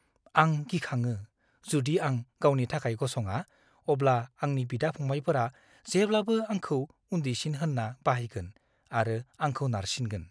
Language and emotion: Bodo, fearful